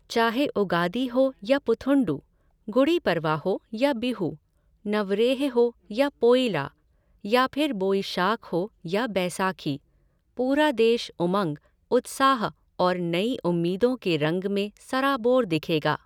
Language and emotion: Hindi, neutral